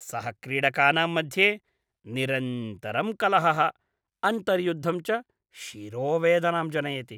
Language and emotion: Sanskrit, disgusted